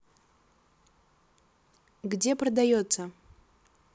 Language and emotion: Russian, neutral